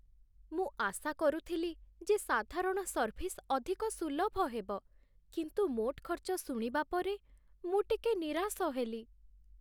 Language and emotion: Odia, sad